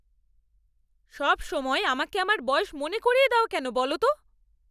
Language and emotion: Bengali, angry